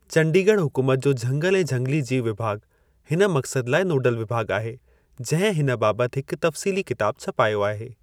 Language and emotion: Sindhi, neutral